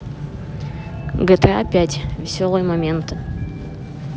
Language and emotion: Russian, neutral